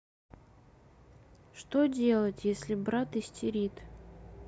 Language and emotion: Russian, sad